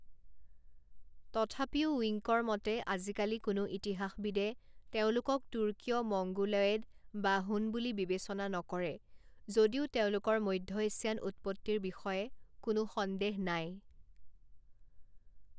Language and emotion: Assamese, neutral